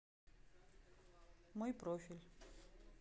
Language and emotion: Russian, neutral